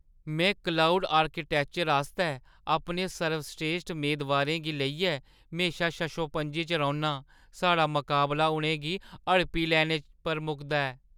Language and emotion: Dogri, fearful